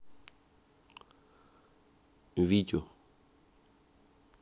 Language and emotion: Russian, neutral